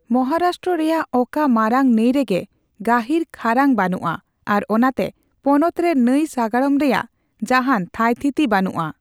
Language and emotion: Santali, neutral